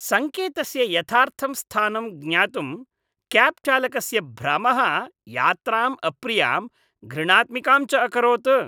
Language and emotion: Sanskrit, disgusted